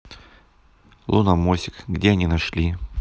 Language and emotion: Russian, neutral